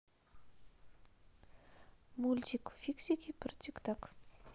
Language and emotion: Russian, neutral